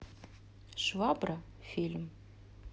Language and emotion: Russian, neutral